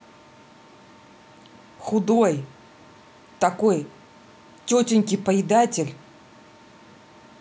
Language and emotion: Russian, angry